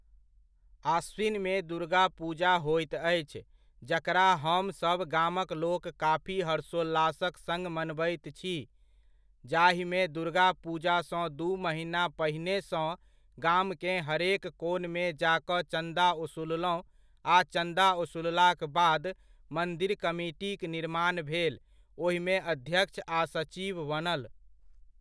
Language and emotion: Maithili, neutral